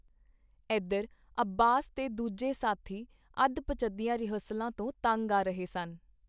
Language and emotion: Punjabi, neutral